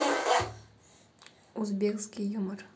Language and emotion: Russian, neutral